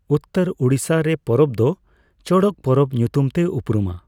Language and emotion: Santali, neutral